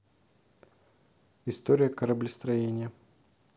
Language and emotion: Russian, neutral